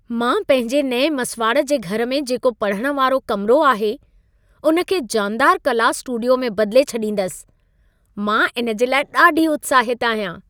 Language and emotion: Sindhi, happy